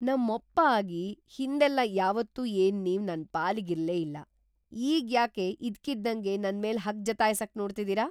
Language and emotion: Kannada, surprised